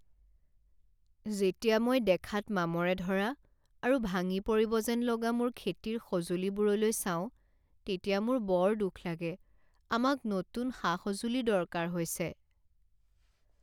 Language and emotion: Assamese, sad